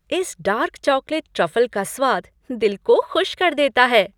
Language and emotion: Hindi, happy